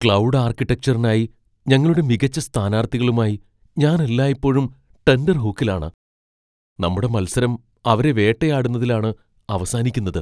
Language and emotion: Malayalam, fearful